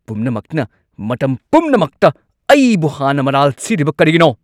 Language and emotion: Manipuri, angry